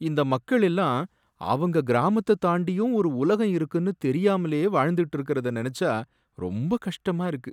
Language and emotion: Tamil, sad